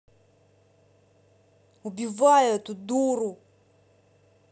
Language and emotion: Russian, angry